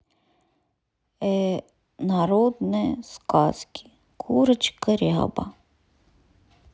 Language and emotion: Russian, sad